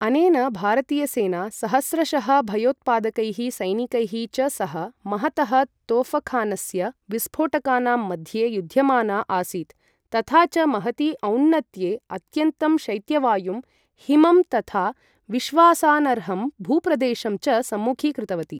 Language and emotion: Sanskrit, neutral